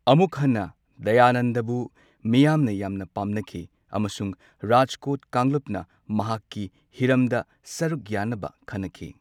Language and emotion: Manipuri, neutral